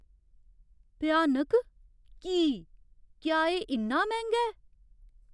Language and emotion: Dogri, fearful